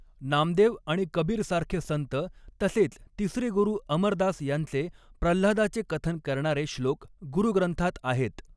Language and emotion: Marathi, neutral